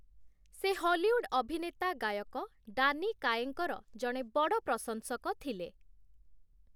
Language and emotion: Odia, neutral